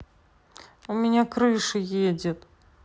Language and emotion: Russian, sad